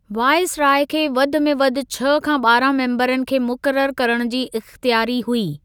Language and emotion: Sindhi, neutral